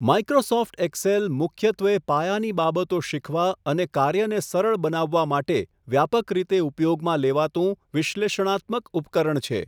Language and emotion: Gujarati, neutral